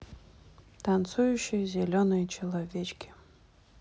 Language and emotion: Russian, neutral